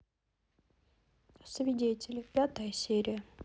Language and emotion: Russian, neutral